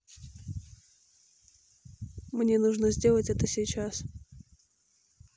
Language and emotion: Russian, neutral